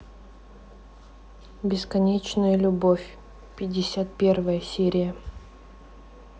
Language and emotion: Russian, neutral